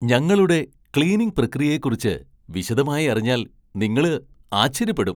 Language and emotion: Malayalam, surprised